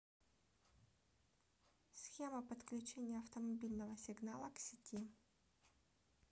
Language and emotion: Russian, neutral